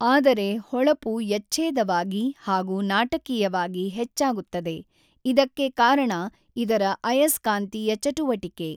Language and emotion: Kannada, neutral